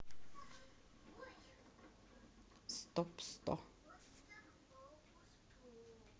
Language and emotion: Russian, neutral